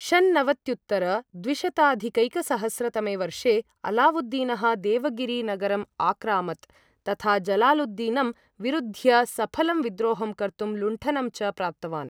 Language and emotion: Sanskrit, neutral